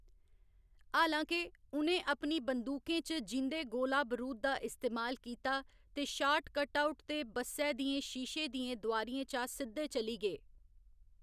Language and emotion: Dogri, neutral